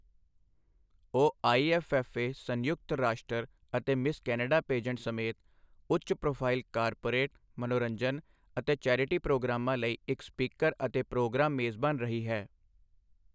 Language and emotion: Punjabi, neutral